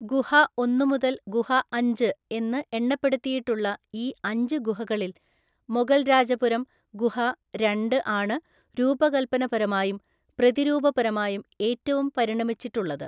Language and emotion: Malayalam, neutral